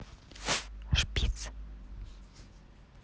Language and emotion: Russian, neutral